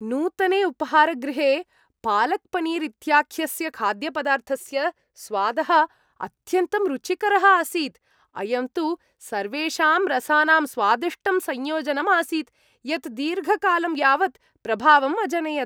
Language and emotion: Sanskrit, happy